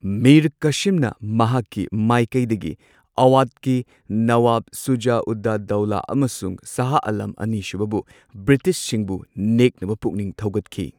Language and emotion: Manipuri, neutral